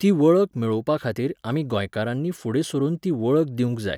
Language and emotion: Goan Konkani, neutral